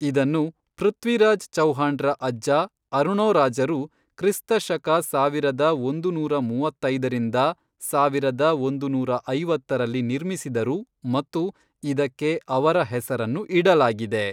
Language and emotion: Kannada, neutral